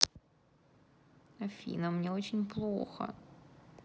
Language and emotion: Russian, sad